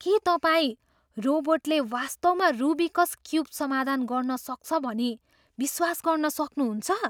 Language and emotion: Nepali, surprised